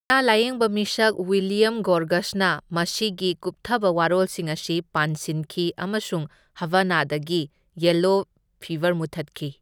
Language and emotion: Manipuri, neutral